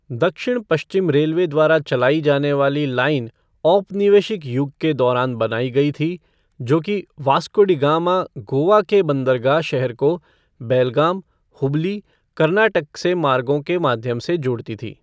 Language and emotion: Hindi, neutral